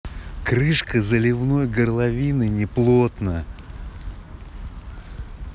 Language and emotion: Russian, angry